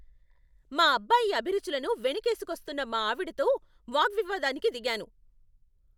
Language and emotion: Telugu, angry